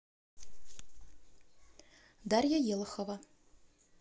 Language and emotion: Russian, neutral